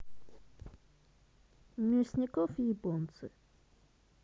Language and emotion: Russian, neutral